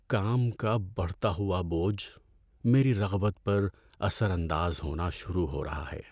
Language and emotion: Urdu, sad